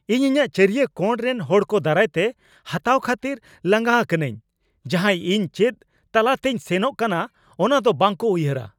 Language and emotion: Santali, angry